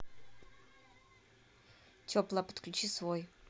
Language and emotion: Russian, neutral